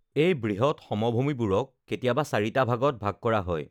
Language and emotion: Assamese, neutral